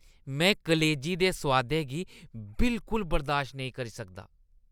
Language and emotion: Dogri, disgusted